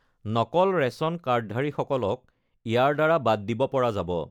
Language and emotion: Assamese, neutral